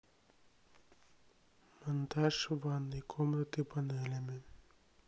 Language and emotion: Russian, sad